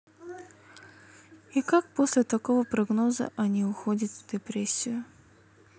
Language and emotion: Russian, sad